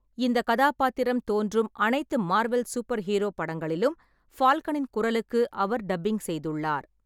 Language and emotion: Tamil, neutral